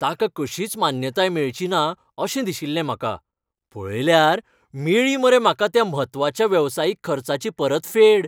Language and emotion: Goan Konkani, happy